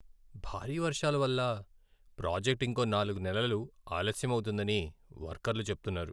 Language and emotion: Telugu, sad